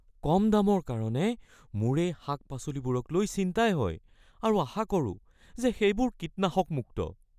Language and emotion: Assamese, fearful